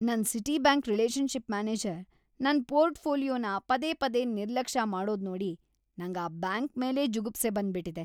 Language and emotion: Kannada, disgusted